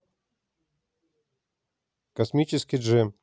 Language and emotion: Russian, neutral